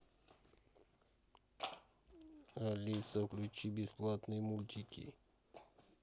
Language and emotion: Russian, neutral